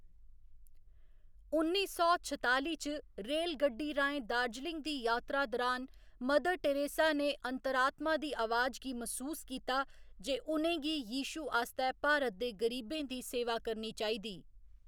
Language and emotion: Dogri, neutral